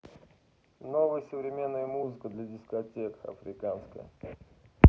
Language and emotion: Russian, neutral